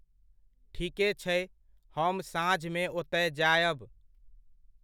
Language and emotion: Maithili, neutral